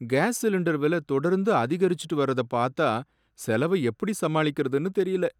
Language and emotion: Tamil, sad